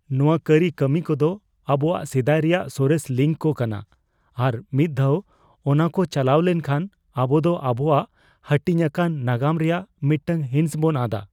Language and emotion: Santali, fearful